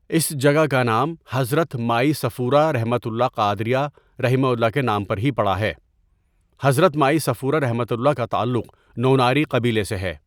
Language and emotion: Urdu, neutral